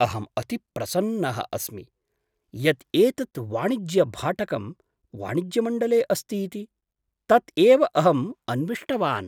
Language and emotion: Sanskrit, surprised